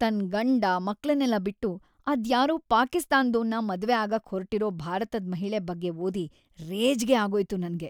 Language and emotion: Kannada, disgusted